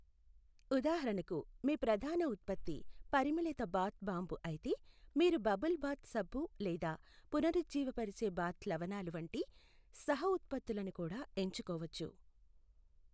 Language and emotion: Telugu, neutral